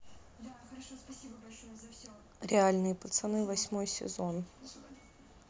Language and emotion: Russian, neutral